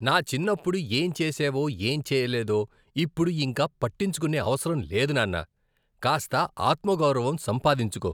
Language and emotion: Telugu, disgusted